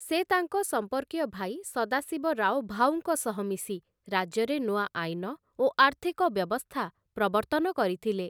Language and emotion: Odia, neutral